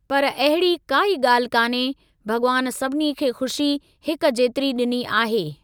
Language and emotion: Sindhi, neutral